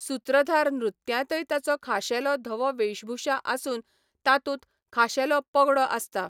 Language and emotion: Goan Konkani, neutral